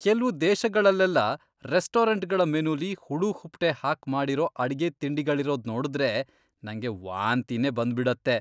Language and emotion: Kannada, disgusted